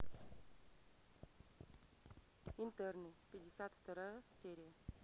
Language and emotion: Russian, neutral